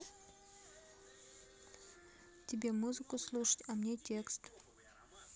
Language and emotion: Russian, neutral